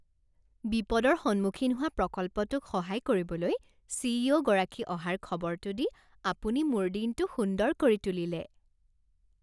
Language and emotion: Assamese, happy